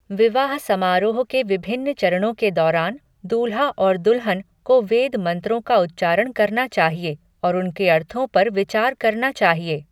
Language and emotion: Hindi, neutral